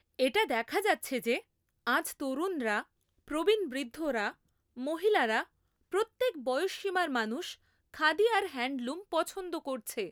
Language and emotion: Bengali, neutral